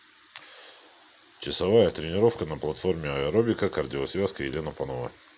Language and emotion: Russian, neutral